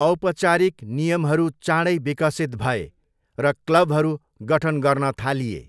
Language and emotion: Nepali, neutral